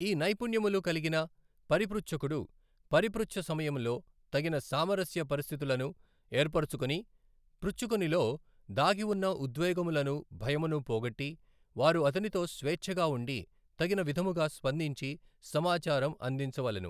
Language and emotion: Telugu, neutral